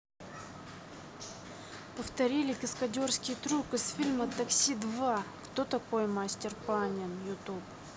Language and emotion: Russian, neutral